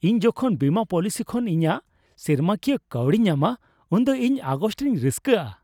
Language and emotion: Santali, happy